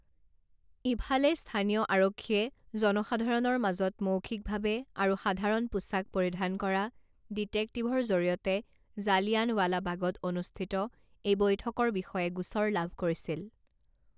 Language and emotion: Assamese, neutral